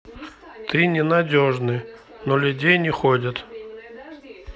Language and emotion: Russian, neutral